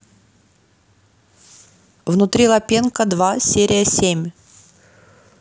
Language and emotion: Russian, neutral